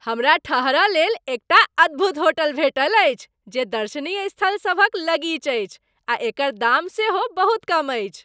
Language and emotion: Maithili, happy